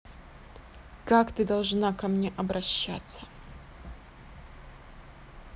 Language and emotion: Russian, angry